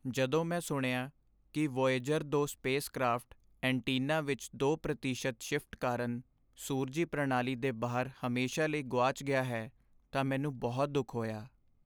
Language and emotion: Punjabi, sad